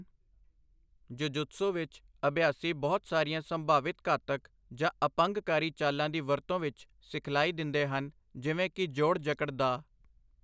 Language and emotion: Punjabi, neutral